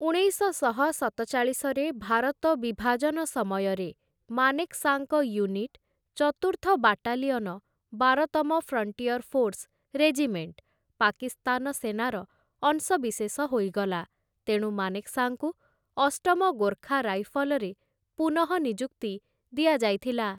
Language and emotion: Odia, neutral